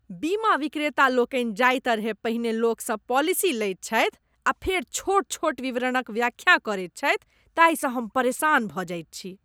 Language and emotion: Maithili, disgusted